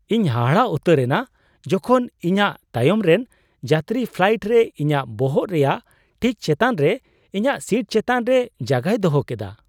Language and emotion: Santali, surprised